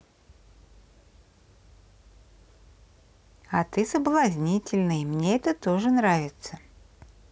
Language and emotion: Russian, positive